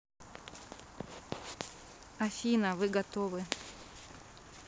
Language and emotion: Russian, neutral